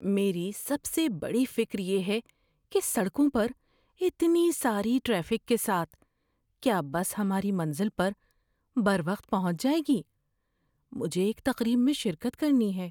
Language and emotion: Urdu, fearful